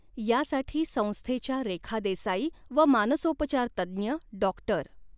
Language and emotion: Marathi, neutral